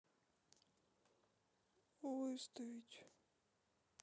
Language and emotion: Russian, sad